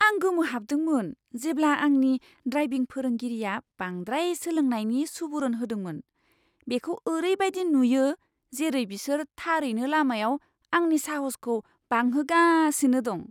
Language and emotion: Bodo, surprised